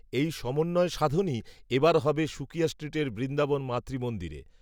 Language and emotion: Bengali, neutral